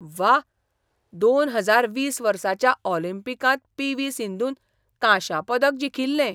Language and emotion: Goan Konkani, surprised